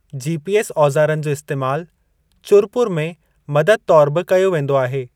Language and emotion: Sindhi, neutral